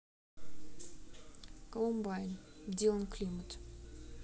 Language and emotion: Russian, neutral